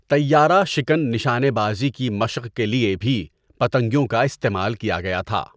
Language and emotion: Urdu, neutral